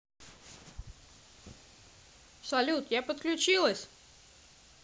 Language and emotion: Russian, positive